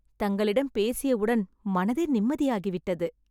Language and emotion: Tamil, happy